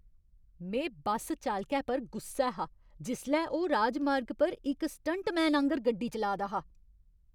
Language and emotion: Dogri, angry